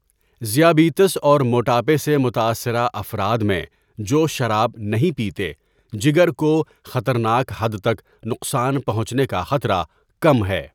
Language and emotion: Urdu, neutral